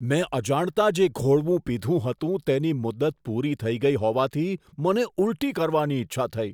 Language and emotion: Gujarati, disgusted